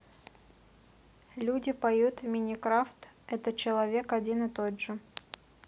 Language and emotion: Russian, neutral